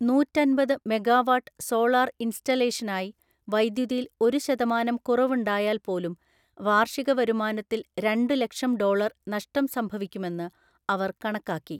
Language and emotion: Malayalam, neutral